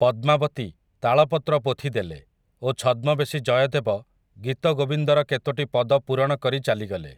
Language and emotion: Odia, neutral